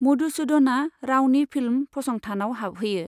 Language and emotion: Bodo, neutral